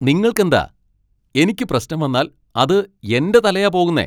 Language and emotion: Malayalam, angry